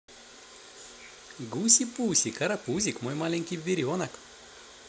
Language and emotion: Russian, positive